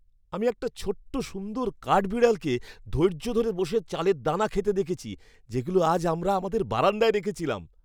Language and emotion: Bengali, happy